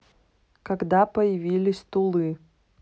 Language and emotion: Russian, neutral